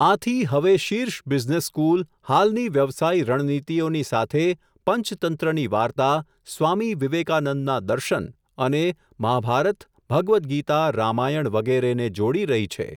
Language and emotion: Gujarati, neutral